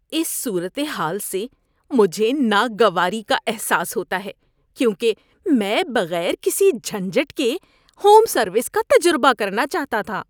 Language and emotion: Urdu, disgusted